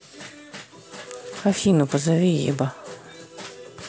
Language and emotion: Russian, neutral